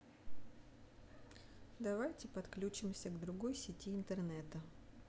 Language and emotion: Russian, neutral